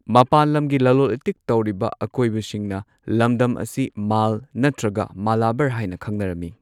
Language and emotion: Manipuri, neutral